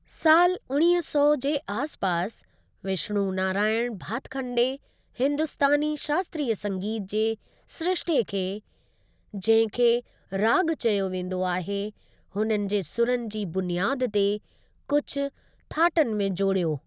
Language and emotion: Sindhi, neutral